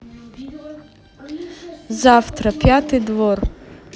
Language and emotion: Russian, neutral